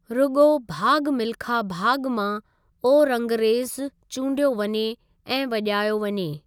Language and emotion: Sindhi, neutral